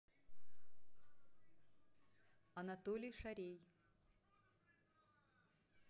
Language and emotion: Russian, neutral